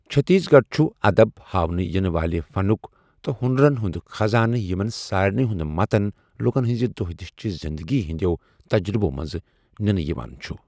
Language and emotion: Kashmiri, neutral